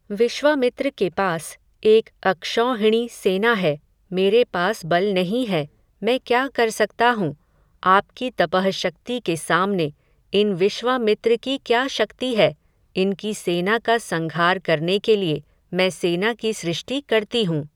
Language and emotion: Hindi, neutral